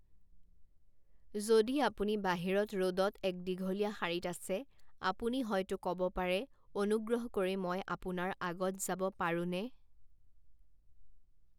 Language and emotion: Assamese, neutral